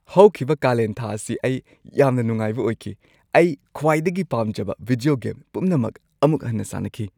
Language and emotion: Manipuri, happy